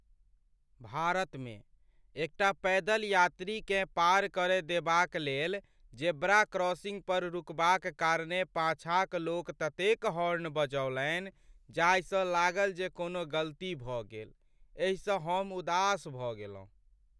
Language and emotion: Maithili, sad